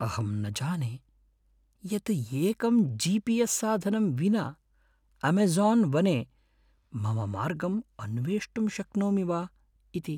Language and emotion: Sanskrit, fearful